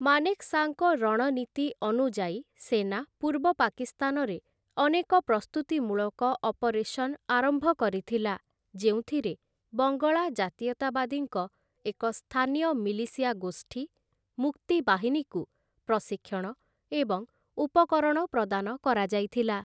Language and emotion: Odia, neutral